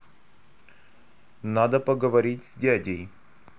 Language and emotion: Russian, neutral